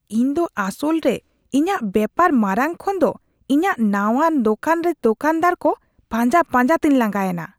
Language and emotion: Santali, disgusted